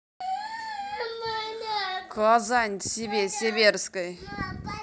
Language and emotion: Russian, angry